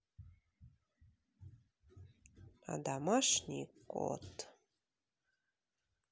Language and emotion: Russian, neutral